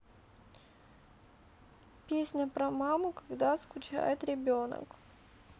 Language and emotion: Russian, sad